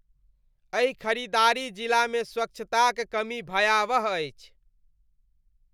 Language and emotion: Maithili, disgusted